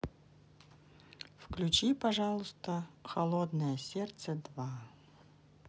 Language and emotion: Russian, neutral